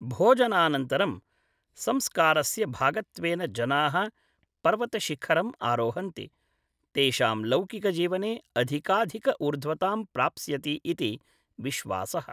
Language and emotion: Sanskrit, neutral